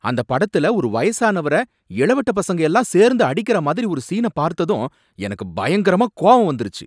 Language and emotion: Tamil, angry